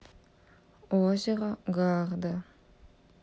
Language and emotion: Russian, neutral